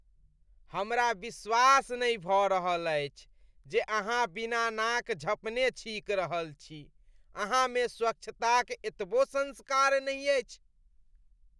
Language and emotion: Maithili, disgusted